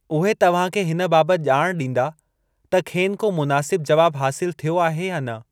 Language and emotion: Sindhi, neutral